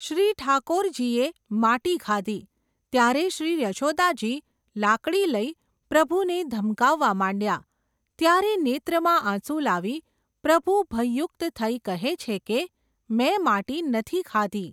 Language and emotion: Gujarati, neutral